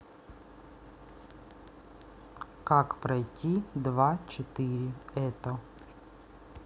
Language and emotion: Russian, neutral